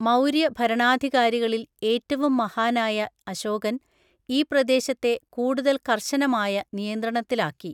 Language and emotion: Malayalam, neutral